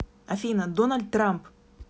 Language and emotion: Russian, neutral